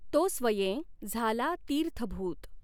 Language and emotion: Marathi, neutral